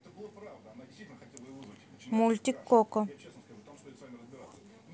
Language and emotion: Russian, neutral